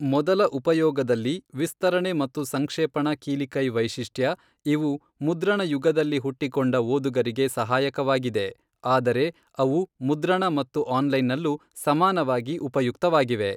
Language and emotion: Kannada, neutral